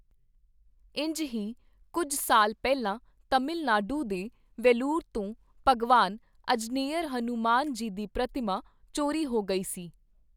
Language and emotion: Punjabi, neutral